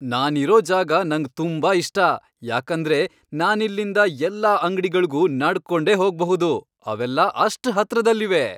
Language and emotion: Kannada, happy